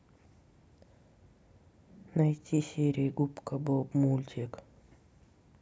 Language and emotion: Russian, sad